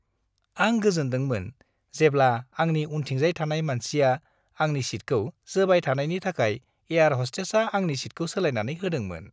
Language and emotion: Bodo, happy